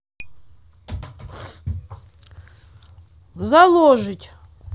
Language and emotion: Russian, neutral